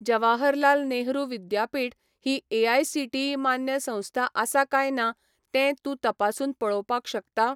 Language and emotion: Goan Konkani, neutral